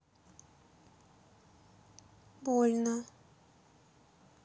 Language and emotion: Russian, neutral